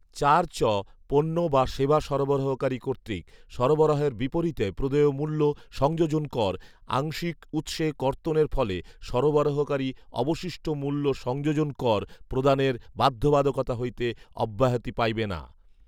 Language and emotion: Bengali, neutral